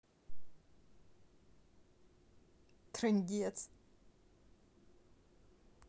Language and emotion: Russian, positive